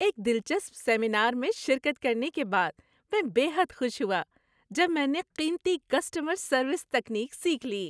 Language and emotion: Urdu, happy